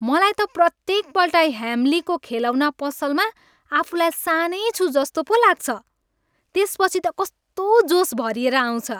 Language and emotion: Nepali, happy